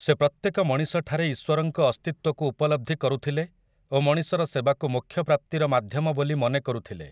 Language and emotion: Odia, neutral